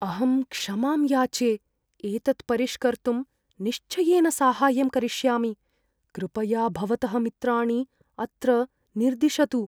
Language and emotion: Sanskrit, fearful